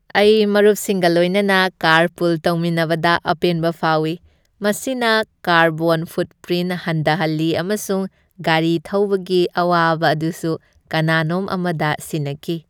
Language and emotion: Manipuri, happy